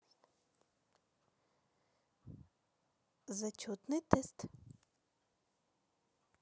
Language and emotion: Russian, positive